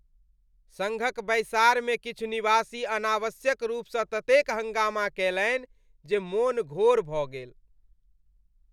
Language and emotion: Maithili, disgusted